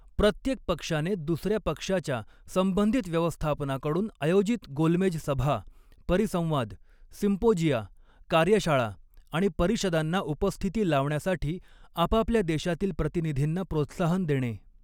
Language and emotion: Marathi, neutral